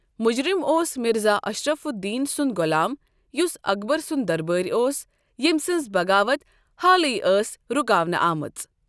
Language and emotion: Kashmiri, neutral